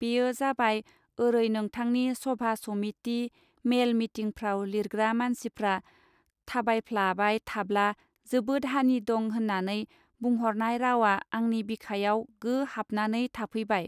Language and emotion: Bodo, neutral